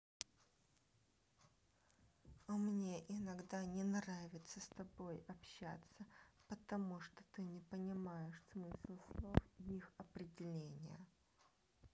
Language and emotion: Russian, neutral